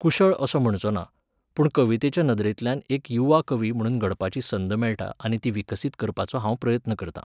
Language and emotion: Goan Konkani, neutral